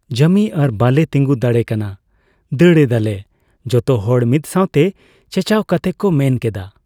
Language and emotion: Santali, neutral